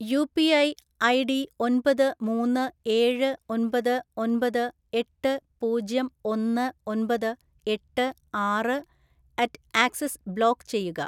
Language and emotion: Malayalam, neutral